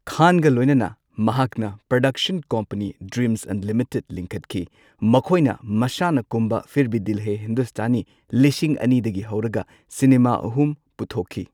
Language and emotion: Manipuri, neutral